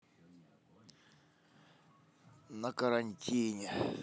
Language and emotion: Russian, sad